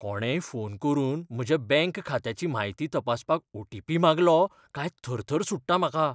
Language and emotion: Goan Konkani, fearful